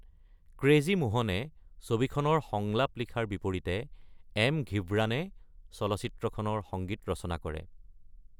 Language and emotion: Assamese, neutral